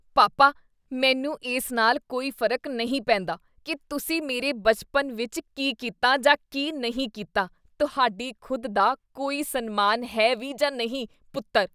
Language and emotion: Punjabi, disgusted